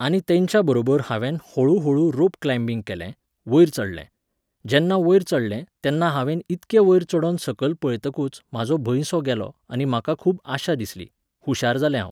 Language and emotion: Goan Konkani, neutral